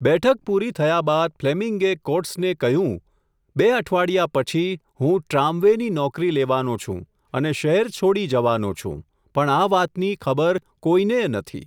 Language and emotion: Gujarati, neutral